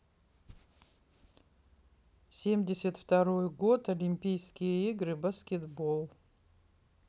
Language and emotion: Russian, neutral